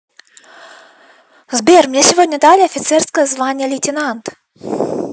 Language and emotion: Russian, positive